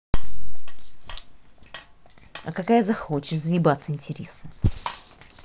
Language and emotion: Russian, angry